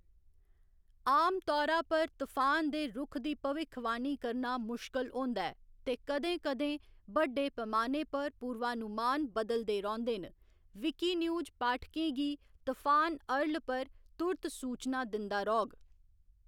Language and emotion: Dogri, neutral